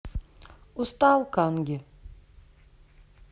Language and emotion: Russian, neutral